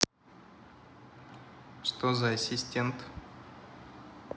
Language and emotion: Russian, neutral